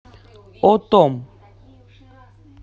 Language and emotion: Russian, neutral